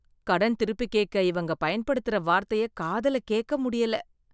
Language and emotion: Tamil, disgusted